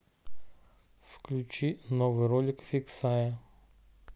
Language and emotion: Russian, neutral